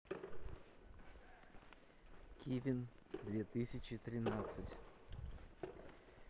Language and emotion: Russian, neutral